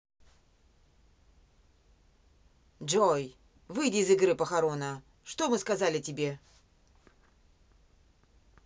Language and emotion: Russian, angry